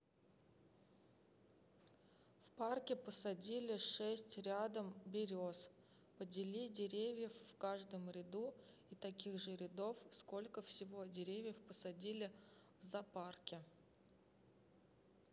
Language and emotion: Russian, neutral